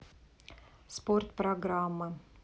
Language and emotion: Russian, neutral